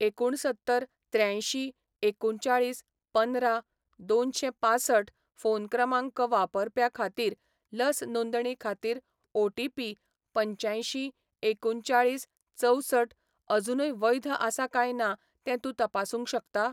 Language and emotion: Goan Konkani, neutral